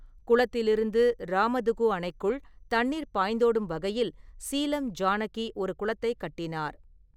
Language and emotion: Tamil, neutral